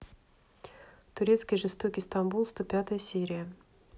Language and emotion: Russian, neutral